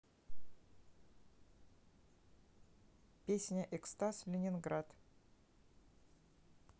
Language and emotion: Russian, neutral